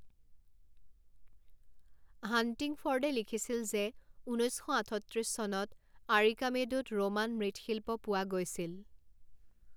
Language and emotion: Assamese, neutral